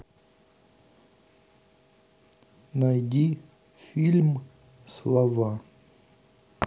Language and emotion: Russian, neutral